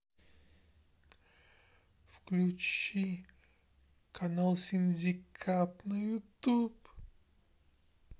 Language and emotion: Russian, sad